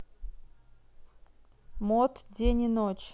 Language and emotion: Russian, neutral